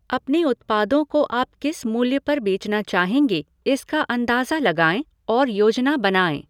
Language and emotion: Hindi, neutral